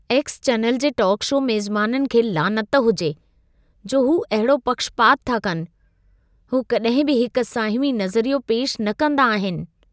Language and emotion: Sindhi, disgusted